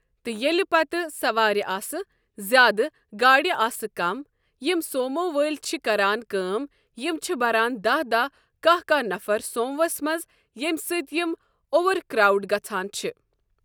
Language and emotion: Kashmiri, neutral